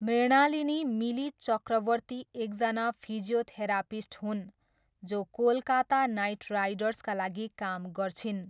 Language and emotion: Nepali, neutral